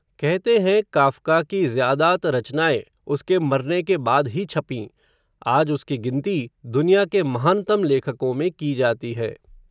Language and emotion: Hindi, neutral